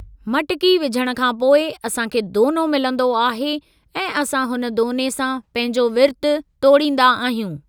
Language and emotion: Sindhi, neutral